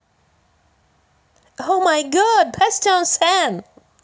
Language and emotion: Russian, positive